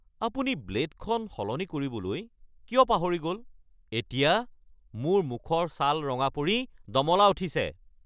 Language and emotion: Assamese, angry